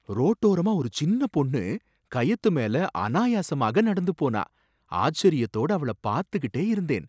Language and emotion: Tamil, surprised